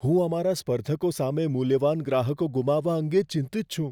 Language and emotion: Gujarati, fearful